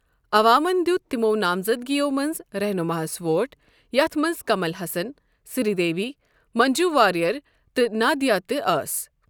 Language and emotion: Kashmiri, neutral